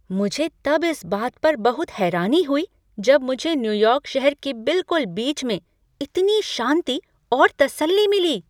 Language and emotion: Hindi, surprised